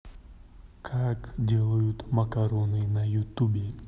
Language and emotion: Russian, neutral